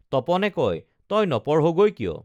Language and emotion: Assamese, neutral